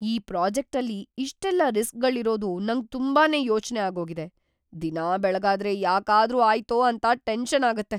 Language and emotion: Kannada, fearful